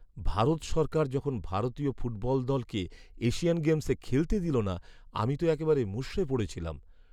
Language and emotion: Bengali, sad